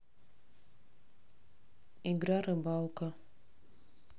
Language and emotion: Russian, neutral